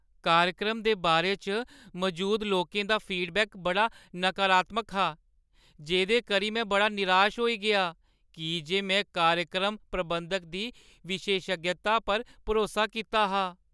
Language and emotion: Dogri, sad